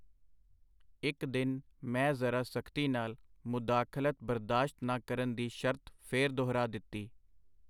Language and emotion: Punjabi, neutral